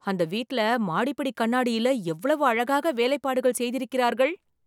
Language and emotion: Tamil, surprised